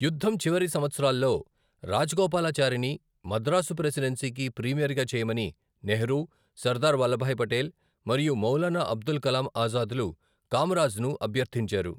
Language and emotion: Telugu, neutral